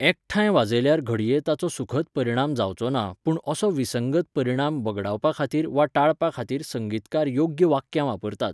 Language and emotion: Goan Konkani, neutral